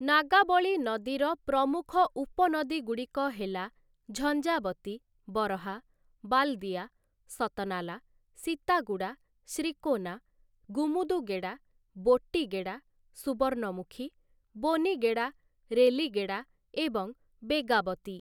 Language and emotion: Odia, neutral